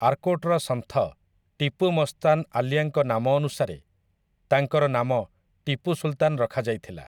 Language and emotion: Odia, neutral